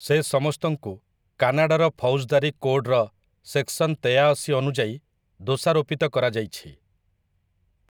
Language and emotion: Odia, neutral